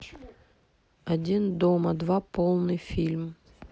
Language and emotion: Russian, neutral